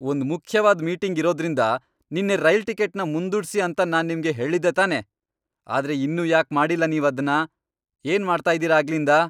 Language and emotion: Kannada, angry